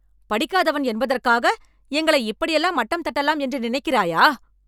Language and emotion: Tamil, angry